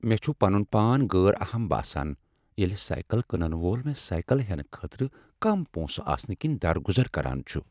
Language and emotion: Kashmiri, sad